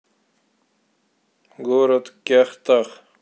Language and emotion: Russian, neutral